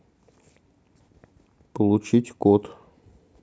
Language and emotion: Russian, neutral